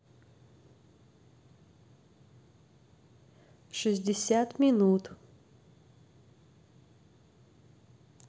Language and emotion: Russian, neutral